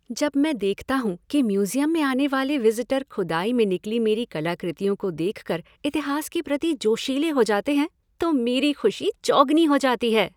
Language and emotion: Hindi, happy